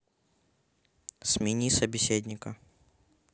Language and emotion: Russian, neutral